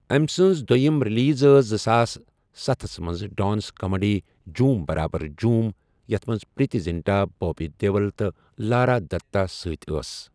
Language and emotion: Kashmiri, neutral